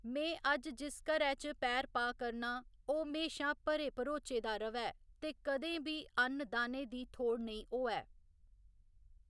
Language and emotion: Dogri, neutral